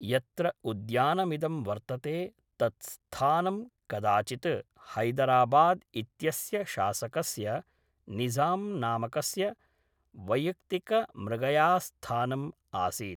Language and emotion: Sanskrit, neutral